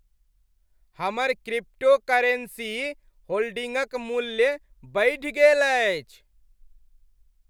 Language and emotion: Maithili, happy